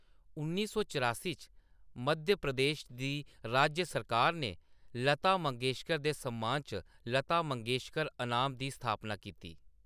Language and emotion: Dogri, neutral